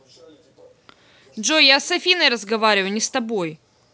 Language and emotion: Russian, angry